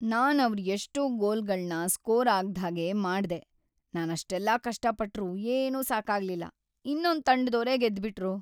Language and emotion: Kannada, sad